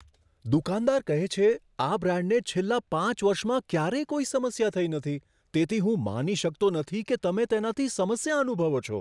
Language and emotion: Gujarati, surprised